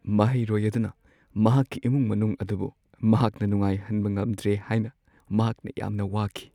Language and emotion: Manipuri, sad